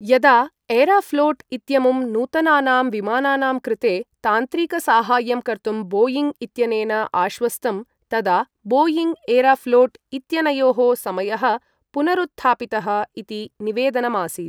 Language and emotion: Sanskrit, neutral